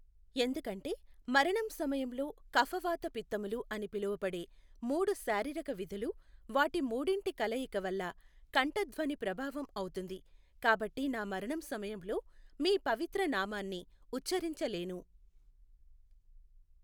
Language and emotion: Telugu, neutral